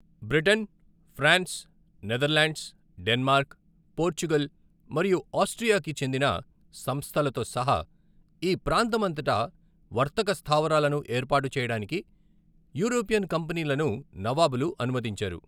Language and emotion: Telugu, neutral